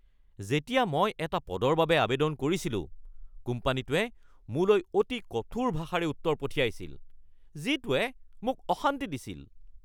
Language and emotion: Assamese, angry